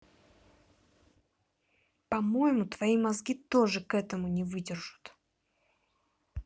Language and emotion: Russian, angry